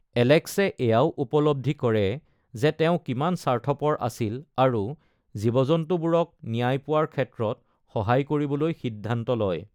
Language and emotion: Assamese, neutral